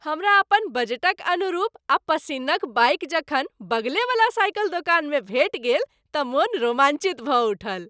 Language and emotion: Maithili, happy